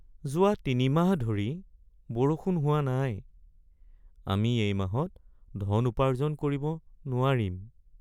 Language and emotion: Assamese, sad